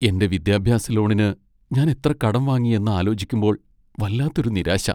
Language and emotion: Malayalam, sad